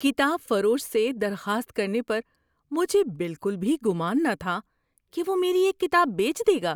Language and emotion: Urdu, surprised